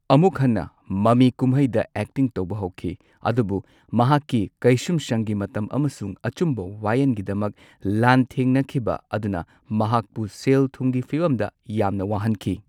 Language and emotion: Manipuri, neutral